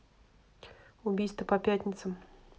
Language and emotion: Russian, neutral